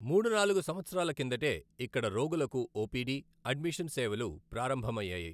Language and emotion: Telugu, neutral